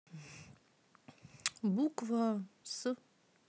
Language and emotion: Russian, neutral